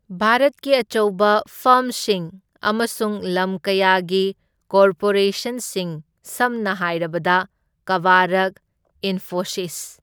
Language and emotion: Manipuri, neutral